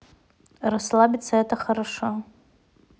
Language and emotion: Russian, neutral